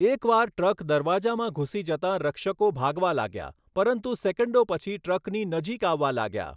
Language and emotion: Gujarati, neutral